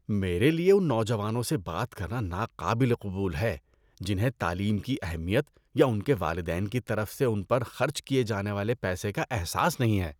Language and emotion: Urdu, disgusted